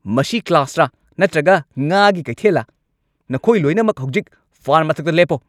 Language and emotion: Manipuri, angry